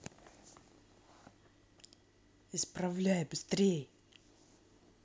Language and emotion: Russian, angry